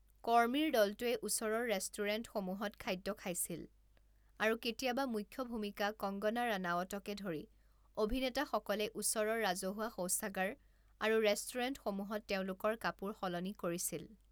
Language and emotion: Assamese, neutral